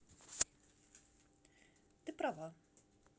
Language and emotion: Russian, neutral